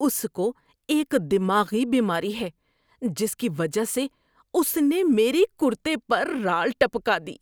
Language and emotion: Urdu, disgusted